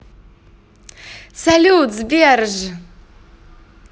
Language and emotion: Russian, positive